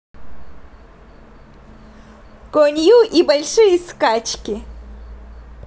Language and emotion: Russian, positive